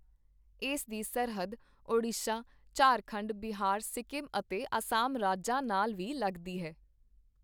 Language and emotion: Punjabi, neutral